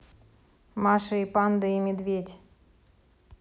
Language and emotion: Russian, neutral